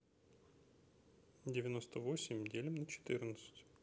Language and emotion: Russian, neutral